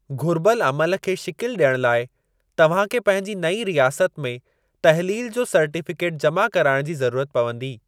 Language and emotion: Sindhi, neutral